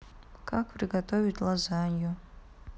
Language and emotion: Russian, sad